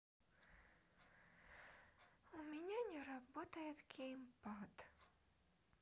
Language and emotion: Russian, sad